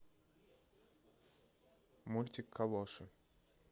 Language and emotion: Russian, neutral